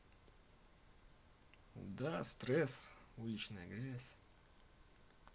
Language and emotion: Russian, neutral